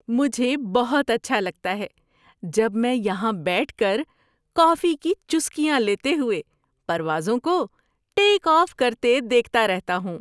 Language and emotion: Urdu, happy